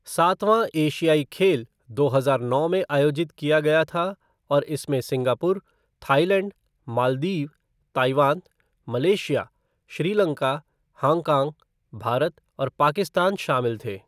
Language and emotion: Hindi, neutral